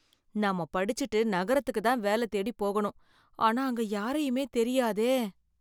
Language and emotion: Tamil, fearful